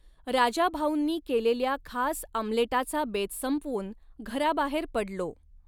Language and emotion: Marathi, neutral